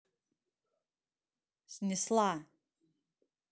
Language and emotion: Russian, angry